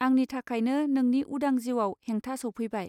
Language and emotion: Bodo, neutral